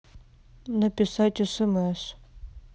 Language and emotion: Russian, neutral